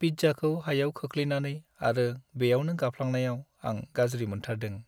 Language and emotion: Bodo, sad